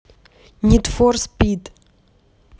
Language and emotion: Russian, neutral